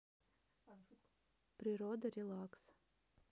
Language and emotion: Russian, neutral